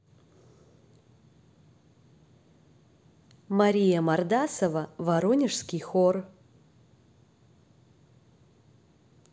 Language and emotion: Russian, neutral